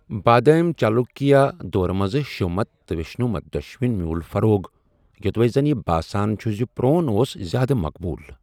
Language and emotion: Kashmiri, neutral